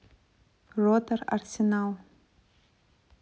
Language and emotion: Russian, neutral